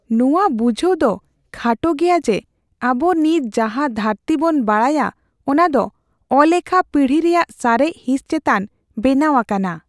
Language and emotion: Santali, fearful